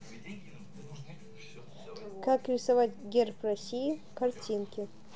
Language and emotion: Russian, neutral